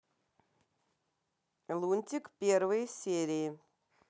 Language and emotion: Russian, neutral